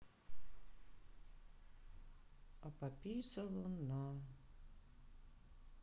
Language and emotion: Russian, sad